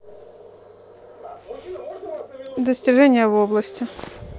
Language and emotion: Russian, neutral